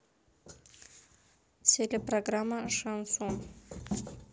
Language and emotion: Russian, neutral